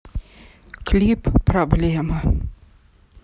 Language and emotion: Russian, sad